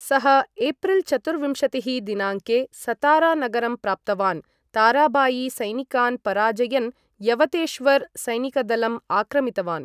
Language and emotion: Sanskrit, neutral